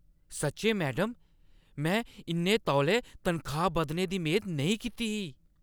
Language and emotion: Dogri, surprised